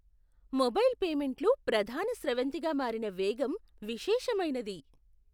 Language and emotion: Telugu, surprised